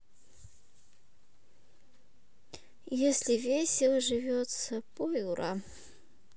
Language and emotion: Russian, sad